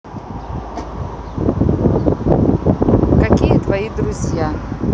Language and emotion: Russian, neutral